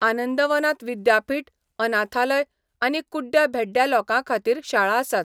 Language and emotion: Goan Konkani, neutral